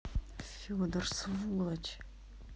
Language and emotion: Russian, angry